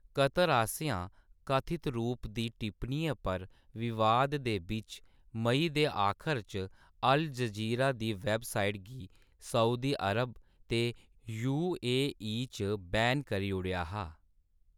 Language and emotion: Dogri, neutral